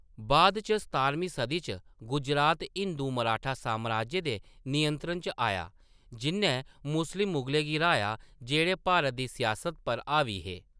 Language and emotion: Dogri, neutral